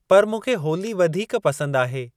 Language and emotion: Sindhi, neutral